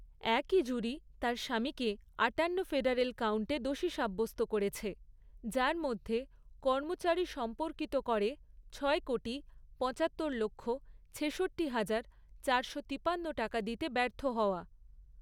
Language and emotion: Bengali, neutral